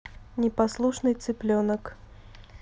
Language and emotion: Russian, neutral